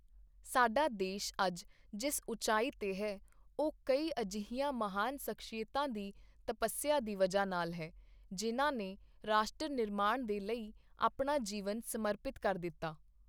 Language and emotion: Punjabi, neutral